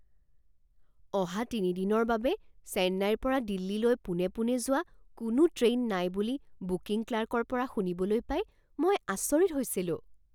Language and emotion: Assamese, surprised